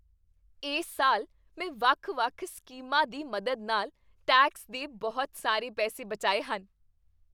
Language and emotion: Punjabi, happy